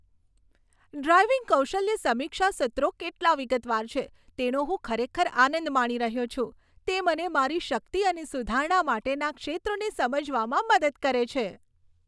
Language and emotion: Gujarati, happy